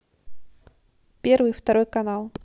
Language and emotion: Russian, neutral